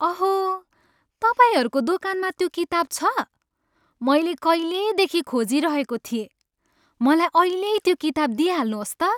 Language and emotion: Nepali, happy